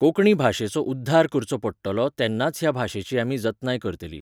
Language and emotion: Goan Konkani, neutral